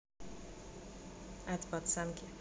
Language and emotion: Russian, neutral